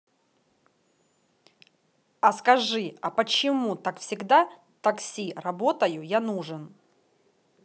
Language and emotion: Russian, angry